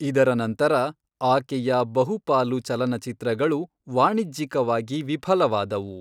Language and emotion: Kannada, neutral